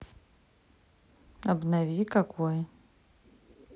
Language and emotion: Russian, neutral